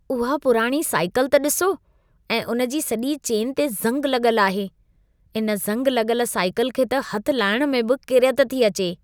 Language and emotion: Sindhi, disgusted